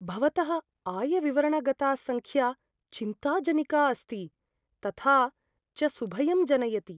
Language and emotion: Sanskrit, fearful